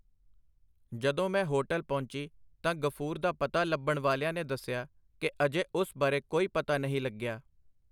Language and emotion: Punjabi, neutral